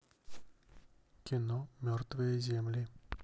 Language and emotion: Russian, neutral